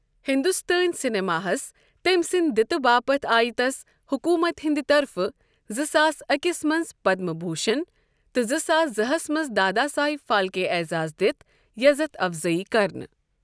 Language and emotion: Kashmiri, neutral